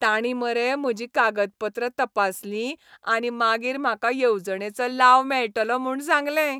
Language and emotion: Goan Konkani, happy